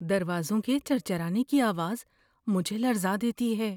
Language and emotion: Urdu, fearful